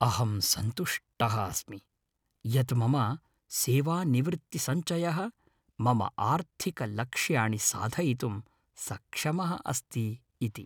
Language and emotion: Sanskrit, happy